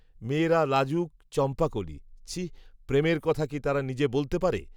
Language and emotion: Bengali, neutral